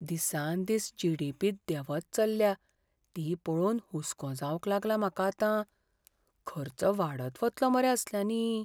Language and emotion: Goan Konkani, fearful